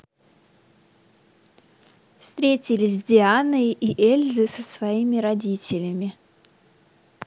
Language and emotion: Russian, neutral